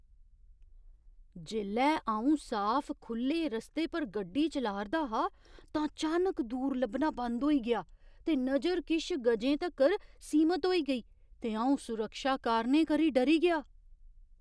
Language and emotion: Dogri, surprised